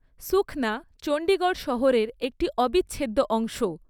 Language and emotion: Bengali, neutral